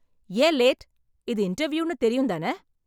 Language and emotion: Tamil, angry